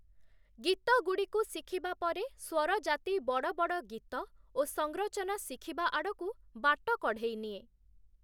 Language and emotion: Odia, neutral